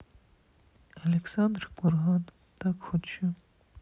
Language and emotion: Russian, sad